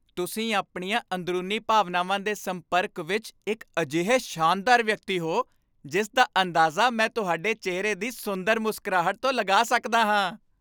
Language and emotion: Punjabi, happy